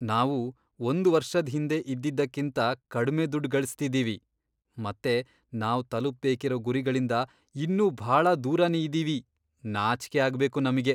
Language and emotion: Kannada, disgusted